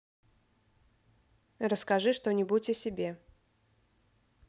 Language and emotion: Russian, neutral